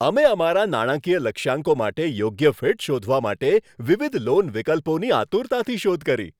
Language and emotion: Gujarati, happy